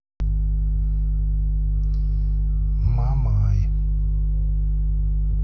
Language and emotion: Russian, neutral